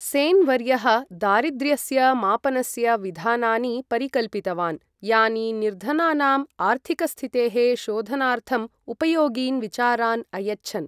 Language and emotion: Sanskrit, neutral